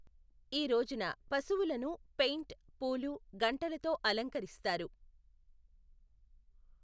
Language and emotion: Telugu, neutral